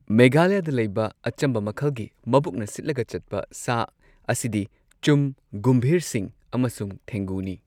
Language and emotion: Manipuri, neutral